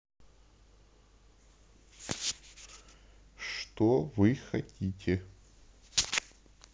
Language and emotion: Russian, neutral